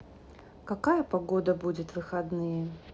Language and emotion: Russian, neutral